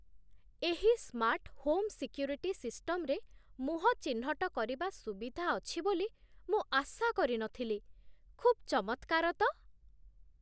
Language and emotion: Odia, surprised